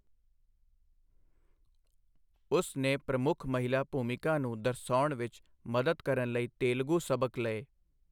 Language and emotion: Punjabi, neutral